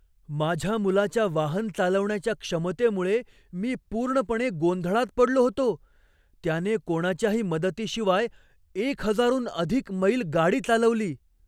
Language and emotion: Marathi, surprised